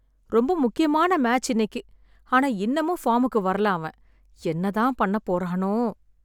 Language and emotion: Tamil, sad